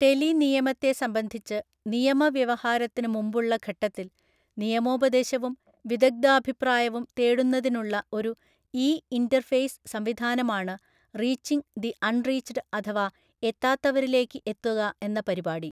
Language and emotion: Malayalam, neutral